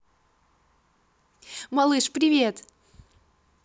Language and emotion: Russian, positive